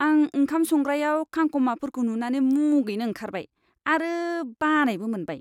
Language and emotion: Bodo, disgusted